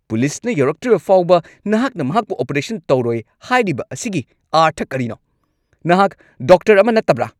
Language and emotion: Manipuri, angry